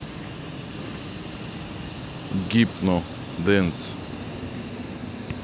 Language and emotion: Russian, neutral